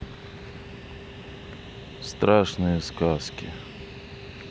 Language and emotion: Russian, neutral